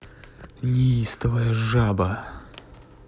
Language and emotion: Russian, angry